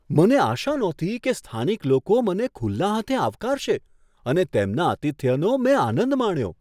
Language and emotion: Gujarati, surprised